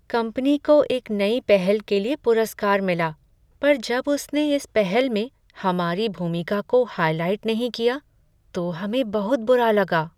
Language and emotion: Hindi, sad